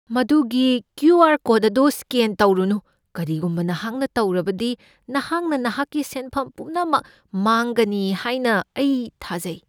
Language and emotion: Manipuri, fearful